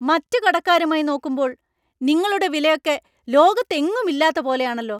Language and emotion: Malayalam, angry